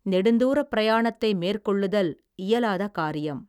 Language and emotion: Tamil, neutral